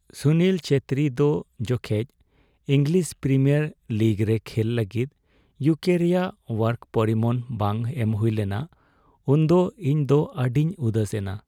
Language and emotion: Santali, sad